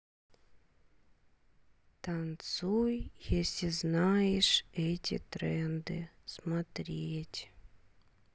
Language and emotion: Russian, sad